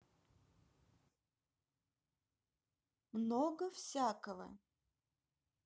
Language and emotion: Russian, neutral